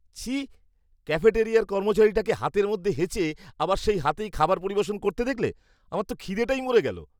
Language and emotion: Bengali, disgusted